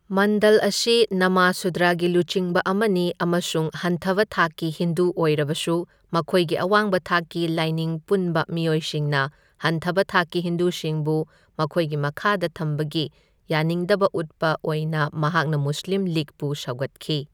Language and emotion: Manipuri, neutral